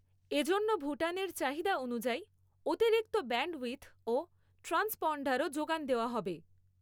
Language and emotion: Bengali, neutral